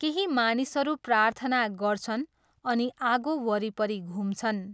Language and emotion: Nepali, neutral